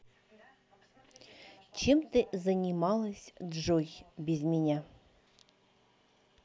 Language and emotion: Russian, neutral